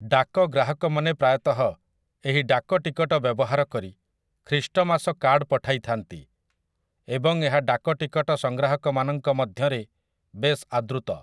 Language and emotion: Odia, neutral